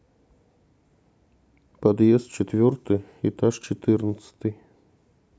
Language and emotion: Russian, neutral